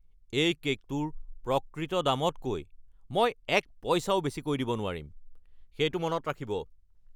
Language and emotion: Assamese, angry